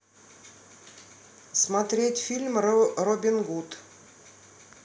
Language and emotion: Russian, neutral